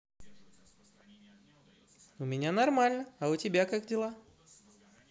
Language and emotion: Russian, positive